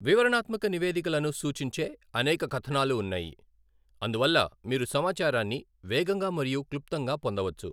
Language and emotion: Telugu, neutral